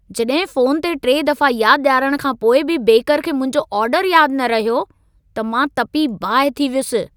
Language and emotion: Sindhi, angry